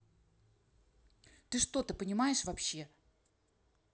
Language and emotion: Russian, angry